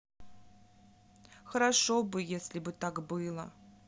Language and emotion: Russian, sad